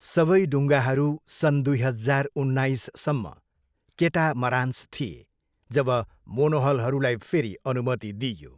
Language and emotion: Nepali, neutral